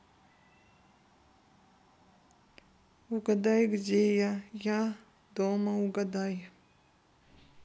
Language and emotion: Russian, sad